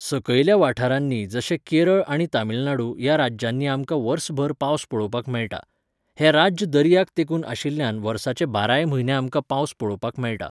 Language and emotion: Goan Konkani, neutral